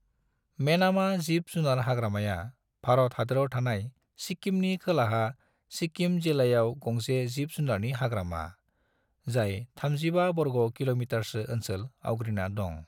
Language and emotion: Bodo, neutral